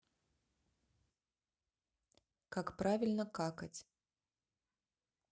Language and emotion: Russian, neutral